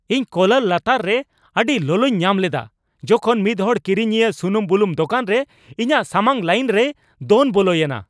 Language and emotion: Santali, angry